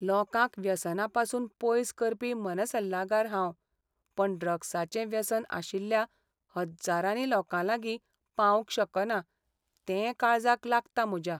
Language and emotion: Goan Konkani, sad